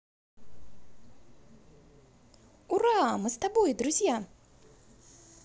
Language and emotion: Russian, positive